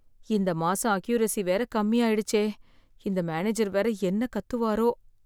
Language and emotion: Tamil, fearful